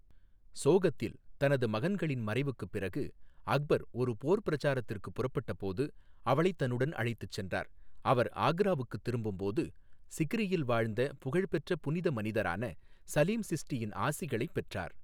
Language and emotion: Tamil, neutral